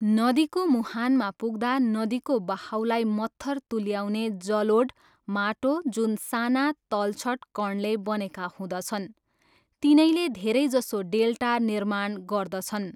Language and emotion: Nepali, neutral